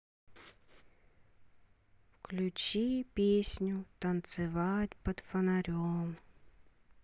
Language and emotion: Russian, neutral